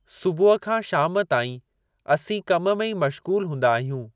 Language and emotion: Sindhi, neutral